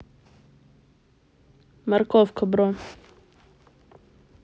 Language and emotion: Russian, neutral